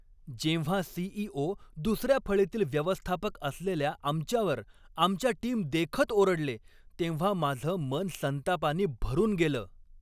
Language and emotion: Marathi, angry